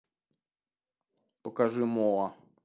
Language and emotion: Russian, neutral